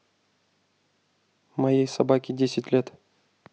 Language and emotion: Russian, neutral